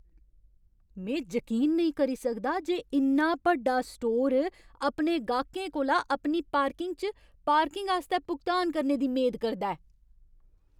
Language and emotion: Dogri, angry